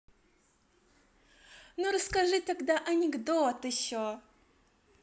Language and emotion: Russian, positive